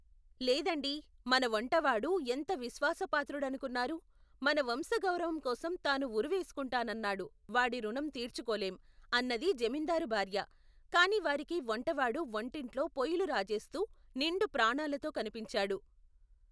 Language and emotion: Telugu, neutral